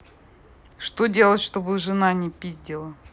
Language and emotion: Russian, neutral